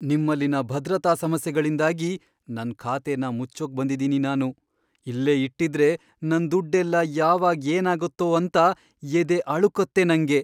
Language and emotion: Kannada, fearful